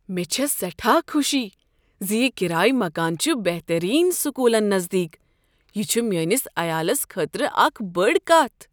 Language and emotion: Kashmiri, surprised